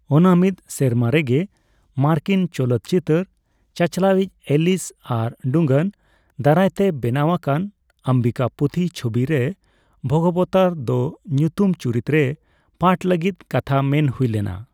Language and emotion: Santali, neutral